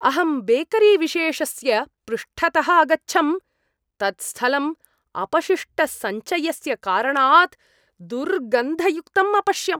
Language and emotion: Sanskrit, disgusted